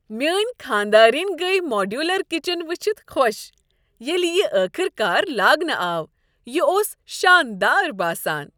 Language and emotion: Kashmiri, happy